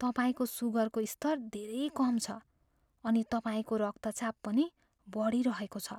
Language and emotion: Nepali, fearful